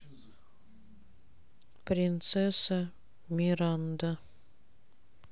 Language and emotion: Russian, neutral